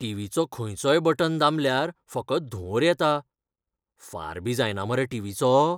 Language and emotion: Goan Konkani, fearful